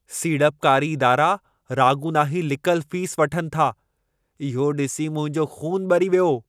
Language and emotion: Sindhi, angry